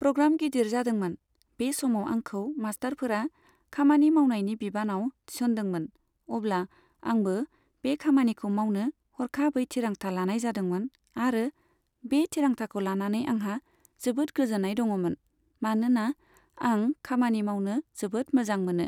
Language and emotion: Bodo, neutral